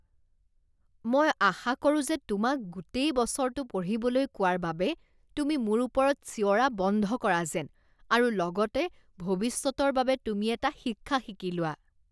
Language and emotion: Assamese, disgusted